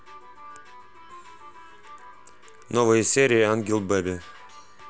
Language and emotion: Russian, neutral